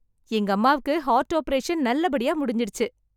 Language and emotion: Tamil, happy